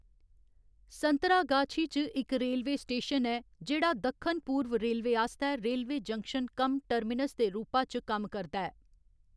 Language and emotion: Dogri, neutral